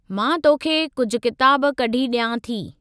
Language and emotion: Sindhi, neutral